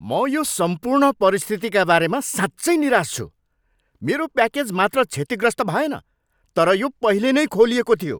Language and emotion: Nepali, angry